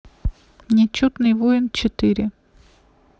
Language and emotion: Russian, neutral